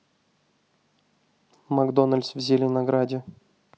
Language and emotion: Russian, neutral